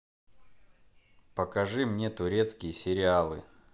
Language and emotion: Russian, neutral